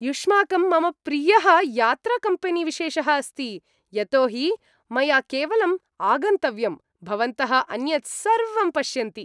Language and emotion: Sanskrit, happy